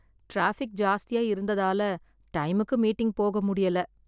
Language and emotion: Tamil, sad